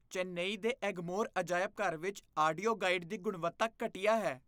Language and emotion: Punjabi, disgusted